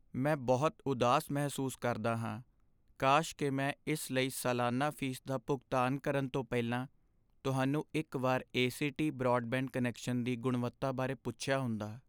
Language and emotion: Punjabi, sad